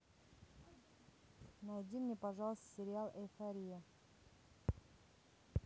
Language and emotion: Russian, neutral